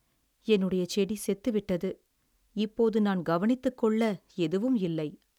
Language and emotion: Tamil, sad